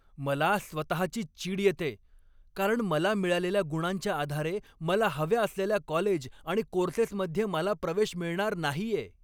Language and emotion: Marathi, angry